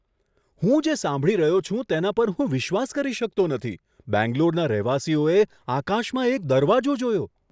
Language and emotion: Gujarati, surprised